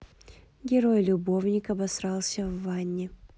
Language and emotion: Russian, neutral